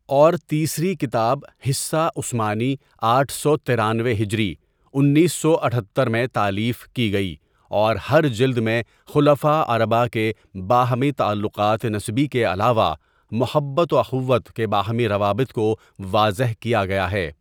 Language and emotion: Urdu, neutral